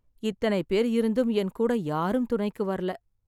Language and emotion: Tamil, sad